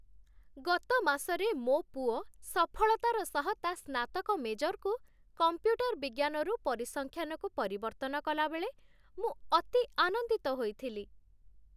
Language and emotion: Odia, happy